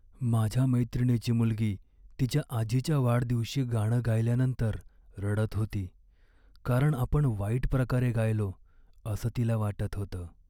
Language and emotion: Marathi, sad